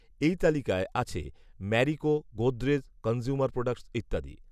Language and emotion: Bengali, neutral